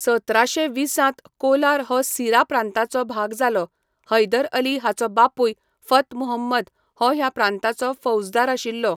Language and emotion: Goan Konkani, neutral